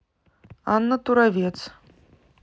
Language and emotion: Russian, neutral